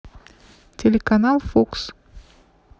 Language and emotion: Russian, neutral